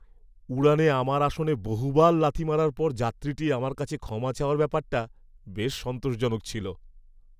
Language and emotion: Bengali, happy